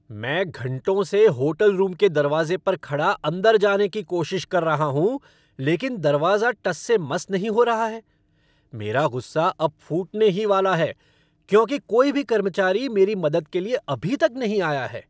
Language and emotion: Hindi, angry